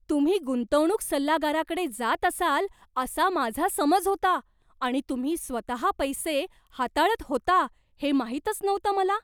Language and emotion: Marathi, surprised